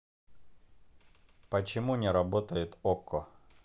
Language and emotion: Russian, neutral